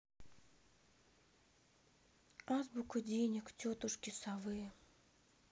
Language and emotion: Russian, sad